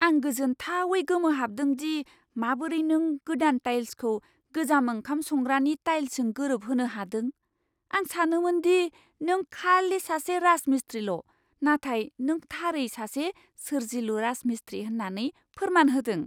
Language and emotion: Bodo, surprised